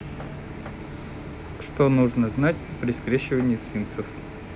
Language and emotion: Russian, neutral